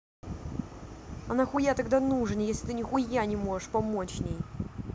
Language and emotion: Russian, angry